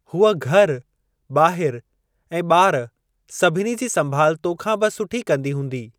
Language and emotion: Sindhi, neutral